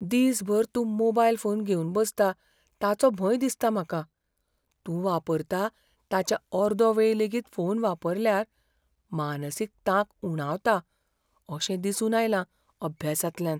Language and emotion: Goan Konkani, fearful